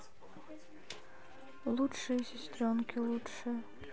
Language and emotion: Russian, sad